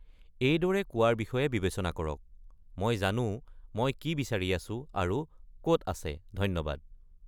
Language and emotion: Assamese, neutral